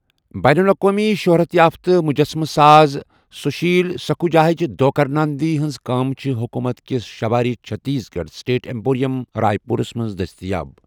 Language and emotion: Kashmiri, neutral